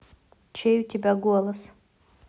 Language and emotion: Russian, neutral